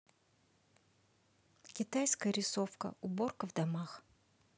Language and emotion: Russian, neutral